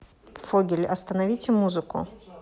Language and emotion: Russian, neutral